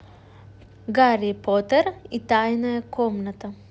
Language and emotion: Russian, positive